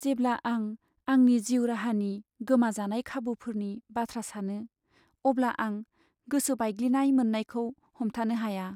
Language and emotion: Bodo, sad